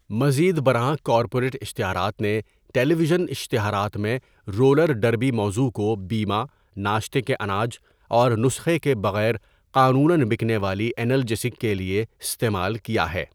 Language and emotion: Urdu, neutral